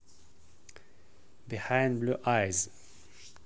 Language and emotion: Russian, neutral